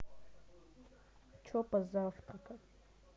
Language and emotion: Russian, neutral